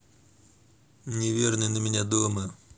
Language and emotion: Russian, neutral